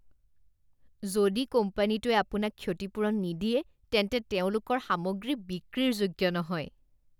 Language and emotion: Assamese, disgusted